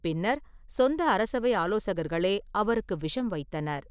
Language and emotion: Tamil, neutral